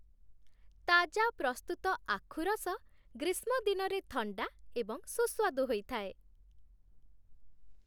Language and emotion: Odia, happy